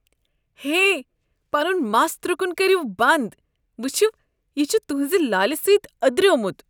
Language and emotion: Kashmiri, disgusted